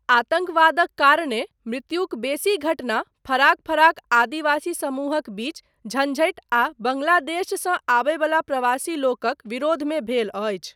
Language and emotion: Maithili, neutral